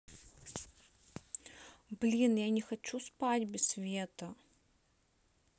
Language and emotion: Russian, neutral